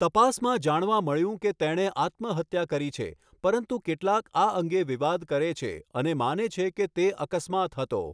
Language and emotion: Gujarati, neutral